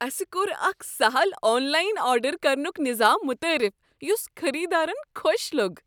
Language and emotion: Kashmiri, happy